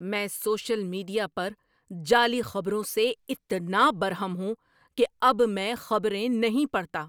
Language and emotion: Urdu, angry